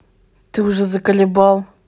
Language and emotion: Russian, angry